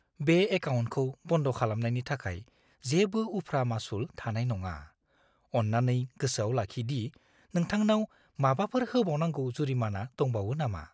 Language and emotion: Bodo, fearful